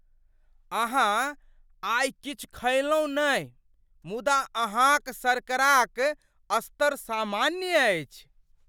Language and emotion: Maithili, surprised